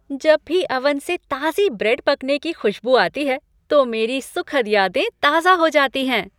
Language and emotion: Hindi, happy